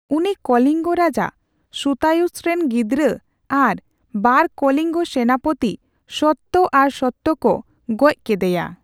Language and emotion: Santali, neutral